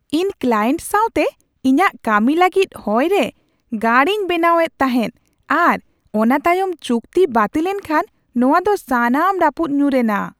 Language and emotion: Santali, surprised